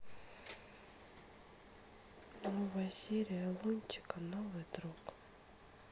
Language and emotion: Russian, sad